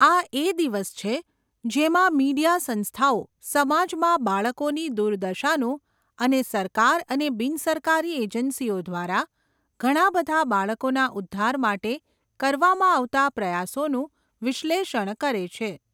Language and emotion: Gujarati, neutral